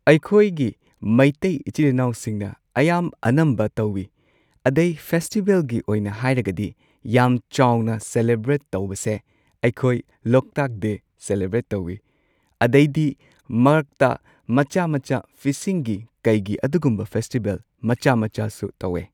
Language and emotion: Manipuri, neutral